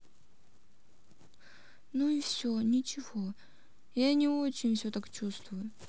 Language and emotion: Russian, sad